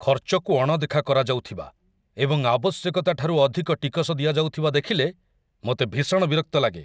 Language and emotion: Odia, angry